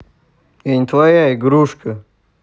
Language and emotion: Russian, angry